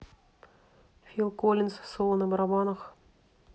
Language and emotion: Russian, neutral